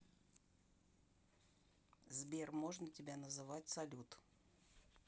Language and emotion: Russian, neutral